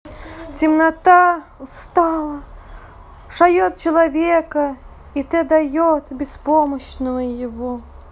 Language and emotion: Russian, sad